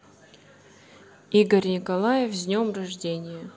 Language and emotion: Russian, neutral